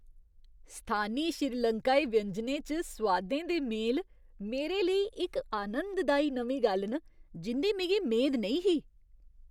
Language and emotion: Dogri, surprised